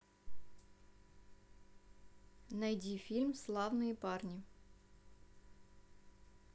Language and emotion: Russian, neutral